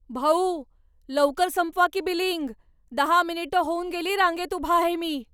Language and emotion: Marathi, angry